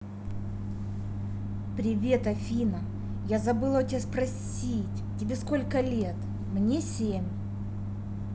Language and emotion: Russian, neutral